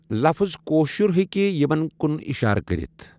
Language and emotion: Kashmiri, neutral